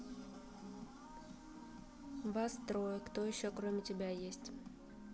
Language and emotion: Russian, neutral